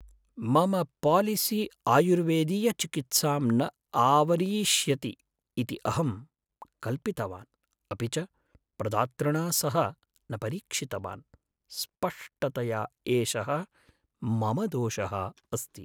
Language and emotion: Sanskrit, sad